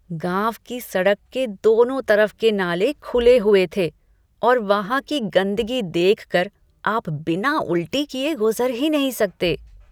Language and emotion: Hindi, disgusted